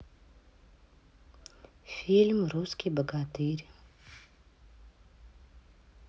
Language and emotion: Russian, neutral